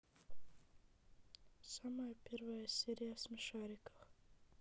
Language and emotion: Russian, neutral